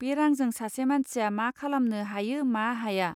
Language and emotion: Bodo, neutral